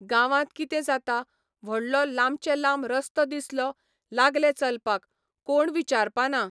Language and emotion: Goan Konkani, neutral